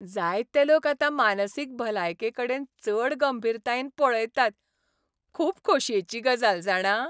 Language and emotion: Goan Konkani, happy